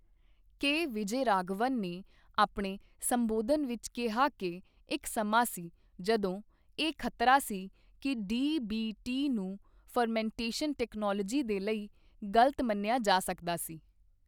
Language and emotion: Punjabi, neutral